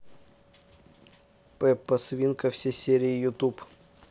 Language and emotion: Russian, neutral